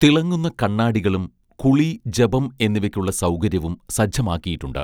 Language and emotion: Malayalam, neutral